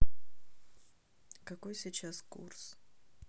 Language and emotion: Russian, neutral